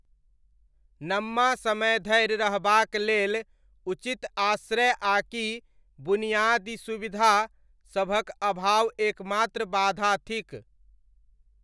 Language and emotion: Maithili, neutral